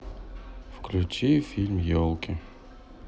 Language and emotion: Russian, sad